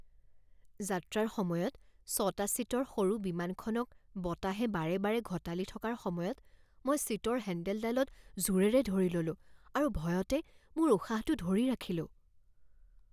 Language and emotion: Assamese, fearful